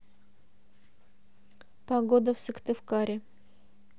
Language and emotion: Russian, neutral